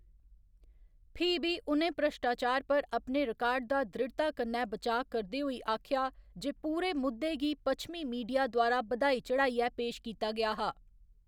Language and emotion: Dogri, neutral